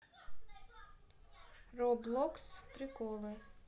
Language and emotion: Russian, neutral